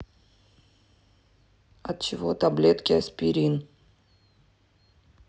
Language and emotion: Russian, neutral